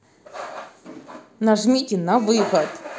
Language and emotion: Russian, angry